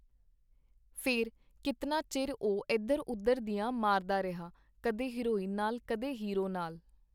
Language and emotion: Punjabi, neutral